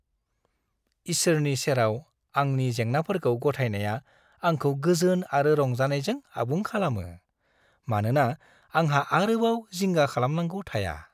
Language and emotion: Bodo, happy